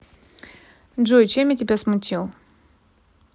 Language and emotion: Russian, neutral